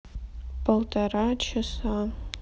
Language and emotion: Russian, sad